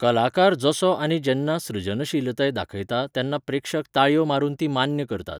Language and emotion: Goan Konkani, neutral